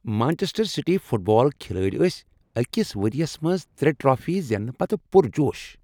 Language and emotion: Kashmiri, happy